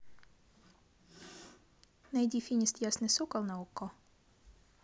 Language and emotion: Russian, neutral